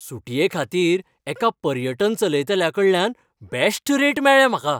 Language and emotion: Goan Konkani, happy